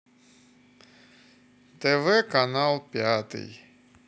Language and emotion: Russian, neutral